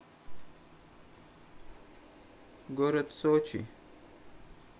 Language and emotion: Russian, neutral